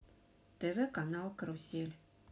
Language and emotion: Russian, neutral